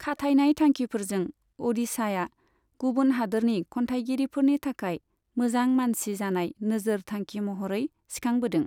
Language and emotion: Bodo, neutral